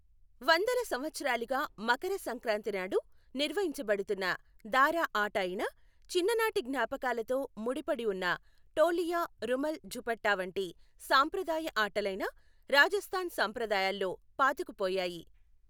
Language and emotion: Telugu, neutral